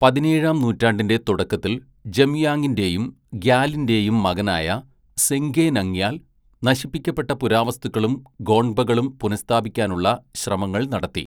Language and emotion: Malayalam, neutral